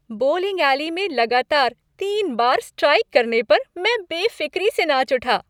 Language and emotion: Hindi, happy